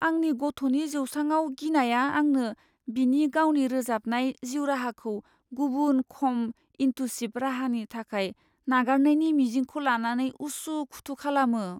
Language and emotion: Bodo, fearful